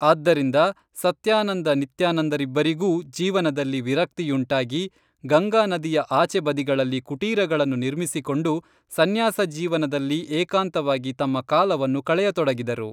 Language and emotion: Kannada, neutral